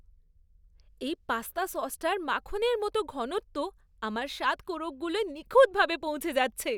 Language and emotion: Bengali, happy